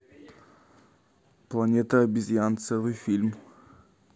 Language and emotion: Russian, neutral